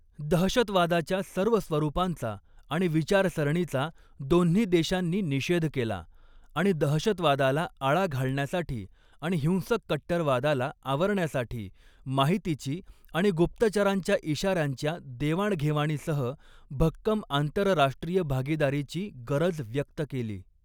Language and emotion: Marathi, neutral